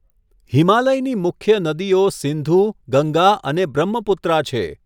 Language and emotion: Gujarati, neutral